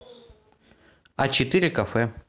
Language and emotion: Russian, neutral